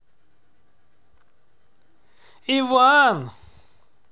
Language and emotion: Russian, neutral